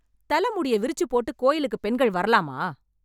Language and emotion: Tamil, angry